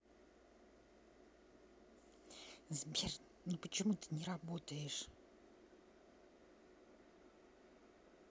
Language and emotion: Russian, angry